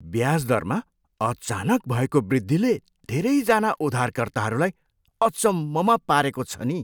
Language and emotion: Nepali, surprised